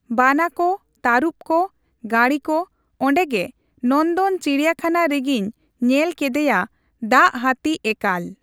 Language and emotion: Santali, neutral